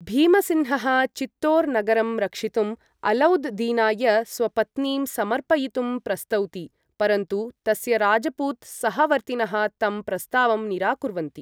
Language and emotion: Sanskrit, neutral